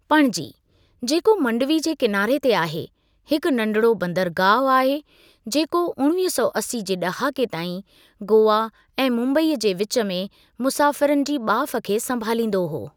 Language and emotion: Sindhi, neutral